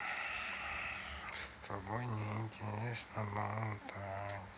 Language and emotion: Russian, sad